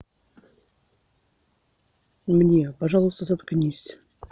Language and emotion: Russian, neutral